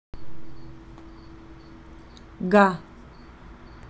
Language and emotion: Russian, neutral